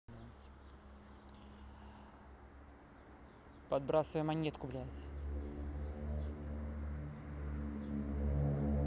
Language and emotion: Russian, neutral